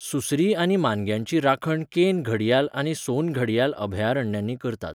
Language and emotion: Goan Konkani, neutral